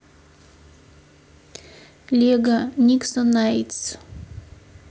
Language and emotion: Russian, neutral